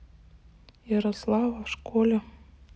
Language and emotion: Russian, neutral